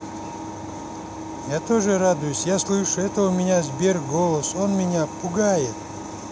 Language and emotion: Russian, neutral